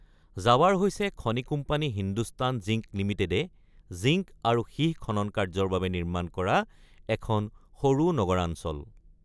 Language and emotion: Assamese, neutral